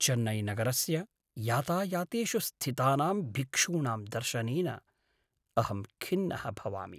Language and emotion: Sanskrit, sad